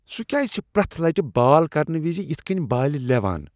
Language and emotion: Kashmiri, disgusted